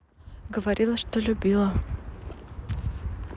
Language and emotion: Russian, neutral